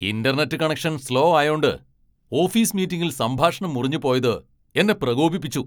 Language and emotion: Malayalam, angry